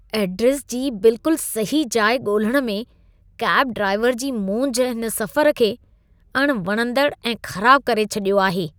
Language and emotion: Sindhi, disgusted